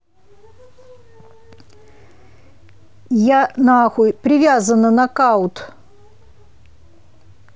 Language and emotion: Russian, angry